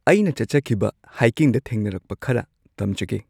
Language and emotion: Manipuri, neutral